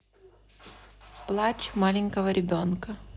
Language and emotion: Russian, neutral